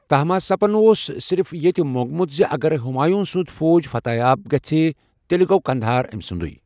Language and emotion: Kashmiri, neutral